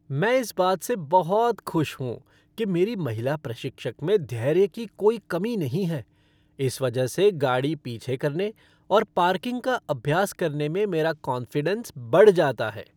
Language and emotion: Hindi, happy